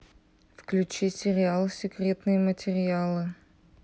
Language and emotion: Russian, neutral